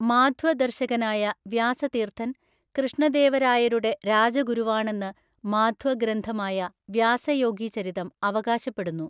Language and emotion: Malayalam, neutral